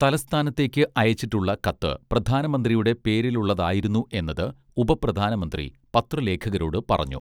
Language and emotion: Malayalam, neutral